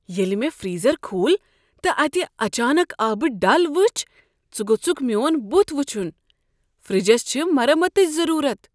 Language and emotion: Kashmiri, surprised